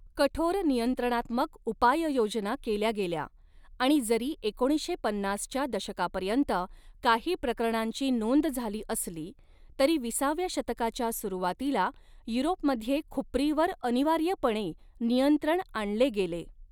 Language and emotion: Marathi, neutral